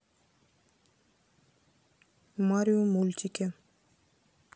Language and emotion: Russian, neutral